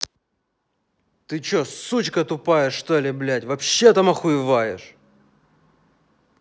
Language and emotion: Russian, angry